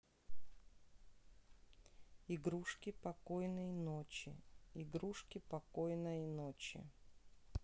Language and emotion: Russian, neutral